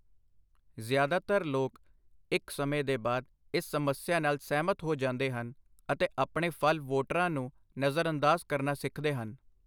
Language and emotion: Punjabi, neutral